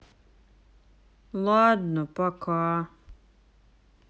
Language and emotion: Russian, sad